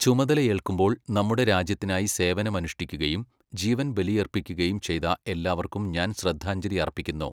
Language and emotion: Malayalam, neutral